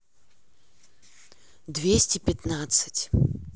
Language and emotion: Russian, neutral